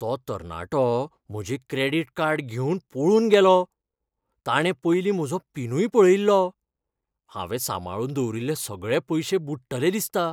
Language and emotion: Goan Konkani, fearful